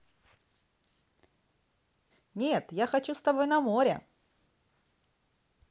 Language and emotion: Russian, positive